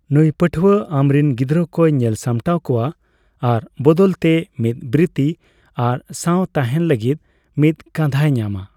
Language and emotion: Santali, neutral